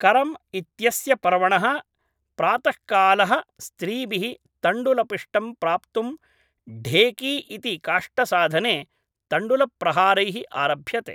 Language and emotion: Sanskrit, neutral